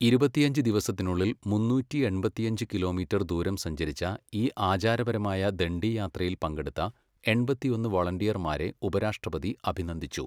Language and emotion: Malayalam, neutral